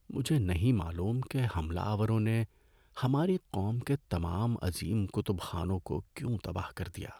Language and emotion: Urdu, sad